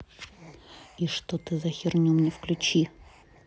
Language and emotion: Russian, angry